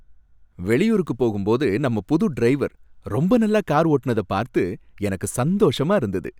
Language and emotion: Tamil, happy